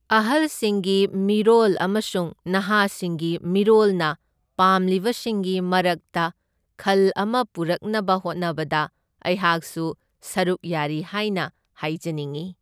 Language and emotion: Manipuri, neutral